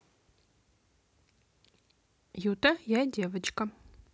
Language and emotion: Russian, neutral